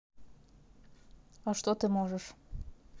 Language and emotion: Russian, neutral